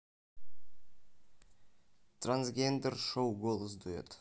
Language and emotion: Russian, neutral